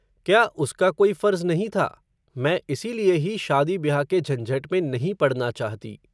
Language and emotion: Hindi, neutral